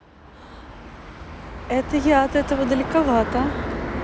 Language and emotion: Russian, neutral